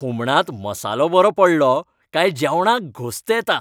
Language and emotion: Goan Konkani, happy